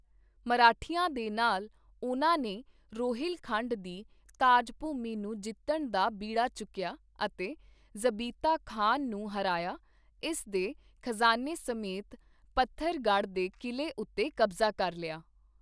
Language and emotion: Punjabi, neutral